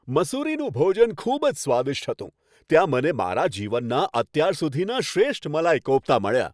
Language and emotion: Gujarati, happy